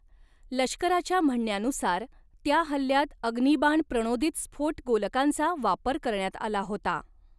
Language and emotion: Marathi, neutral